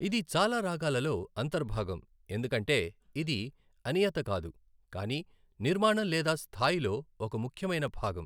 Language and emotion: Telugu, neutral